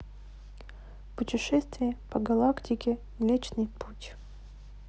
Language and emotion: Russian, neutral